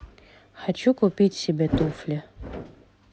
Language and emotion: Russian, neutral